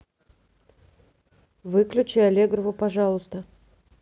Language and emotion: Russian, neutral